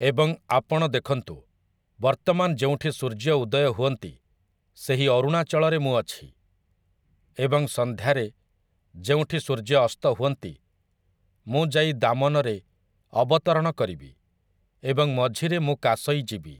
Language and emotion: Odia, neutral